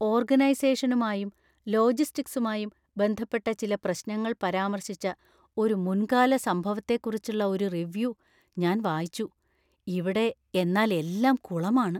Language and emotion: Malayalam, fearful